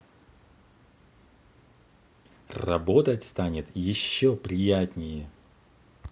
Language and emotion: Russian, positive